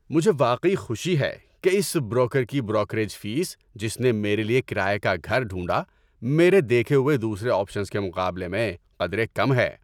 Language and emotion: Urdu, happy